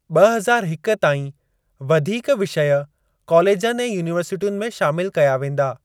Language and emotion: Sindhi, neutral